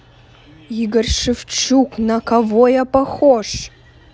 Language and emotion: Russian, angry